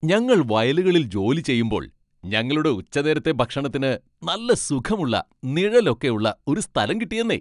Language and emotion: Malayalam, happy